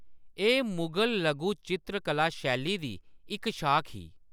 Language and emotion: Dogri, neutral